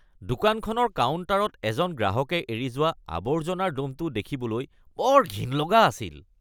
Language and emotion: Assamese, disgusted